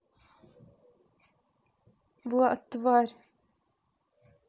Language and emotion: Russian, angry